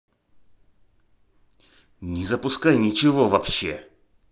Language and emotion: Russian, angry